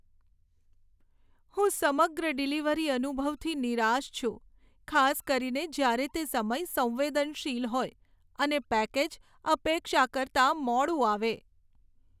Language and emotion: Gujarati, sad